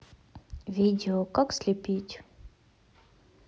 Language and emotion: Russian, neutral